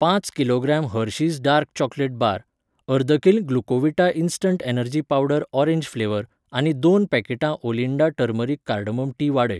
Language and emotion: Goan Konkani, neutral